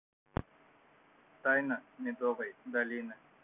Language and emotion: Russian, neutral